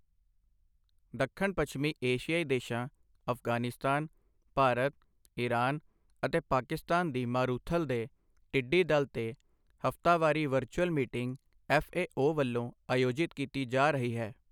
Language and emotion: Punjabi, neutral